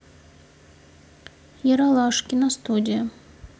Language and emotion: Russian, neutral